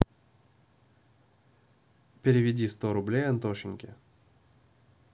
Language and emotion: Russian, neutral